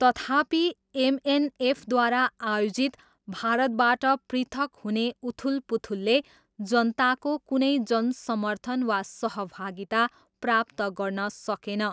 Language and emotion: Nepali, neutral